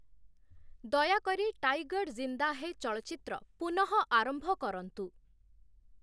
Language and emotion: Odia, neutral